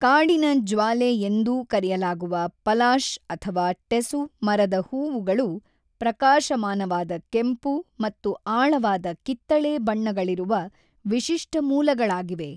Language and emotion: Kannada, neutral